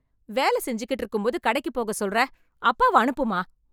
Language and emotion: Tamil, angry